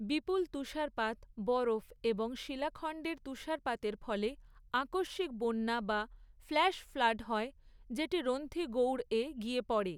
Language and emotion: Bengali, neutral